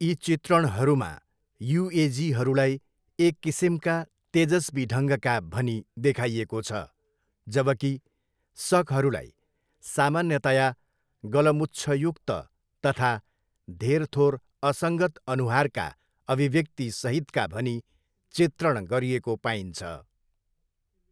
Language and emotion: Nepali, neutral